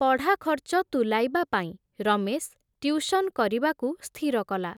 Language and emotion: Odia, neutral